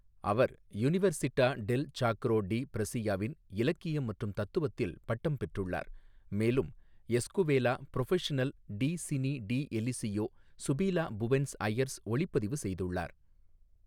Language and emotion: Tamil, neutral